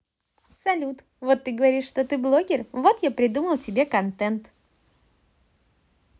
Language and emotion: Russian, positive